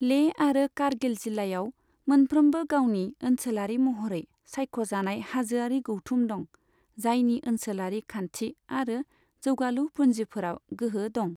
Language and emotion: Bodo, neutral